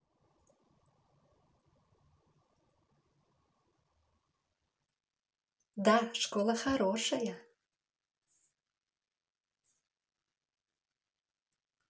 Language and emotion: Russian, positive